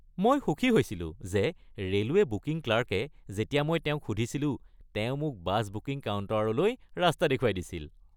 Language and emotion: Assamese, happy